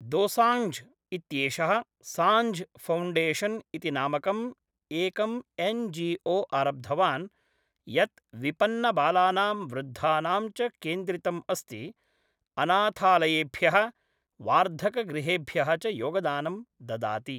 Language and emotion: Sanskrit, neutral